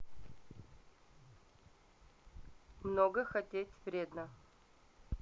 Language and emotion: Russian, neutral